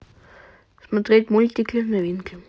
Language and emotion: Russian, neutral